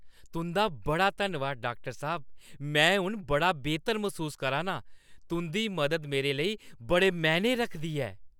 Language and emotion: Dogri, happy